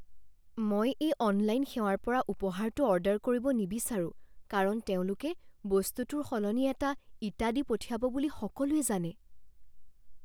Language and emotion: Assamese, fearful